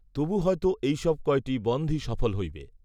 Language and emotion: Bengali, neutral